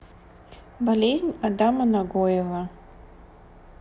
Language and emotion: Russian, neutral